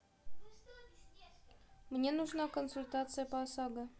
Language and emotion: Russian, neutral